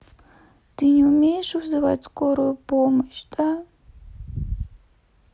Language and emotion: Russian, sad